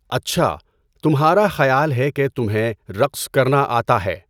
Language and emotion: Urdu, neutral